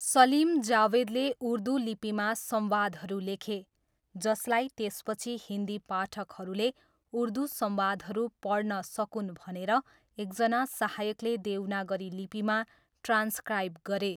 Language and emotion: Nepali, neutral